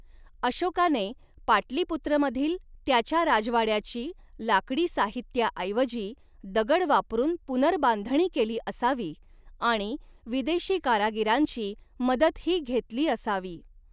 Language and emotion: Marathi, neutral